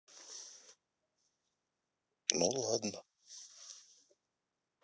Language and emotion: Russian, sad